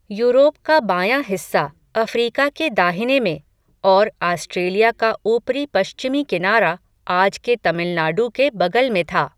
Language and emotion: Hindi, neutral